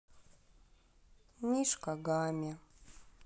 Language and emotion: Russian, sad